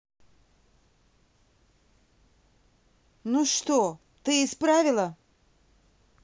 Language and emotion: Russian, angry